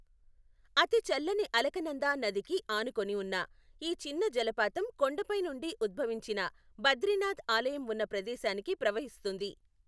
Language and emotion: Telugu, neutral